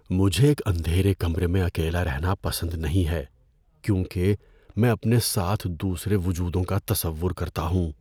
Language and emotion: Urdu, fearful